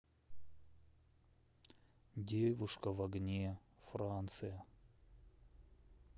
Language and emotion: Russian, sad